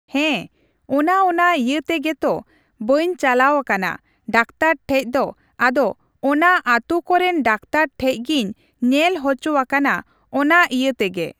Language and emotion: Santali, neutral